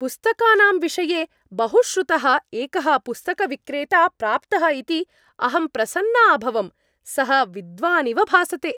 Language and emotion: Sanskrit, happy